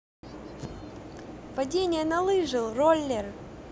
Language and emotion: Russian, neutral